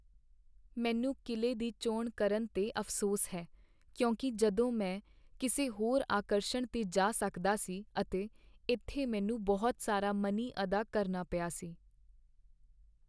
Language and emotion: Punjabi, sad